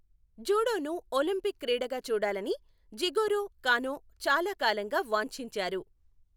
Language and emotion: Telugu, neutral